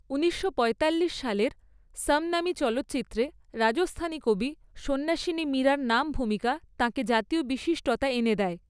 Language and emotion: Bengali, neutral